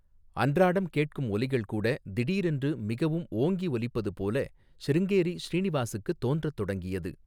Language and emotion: Tamil, neutral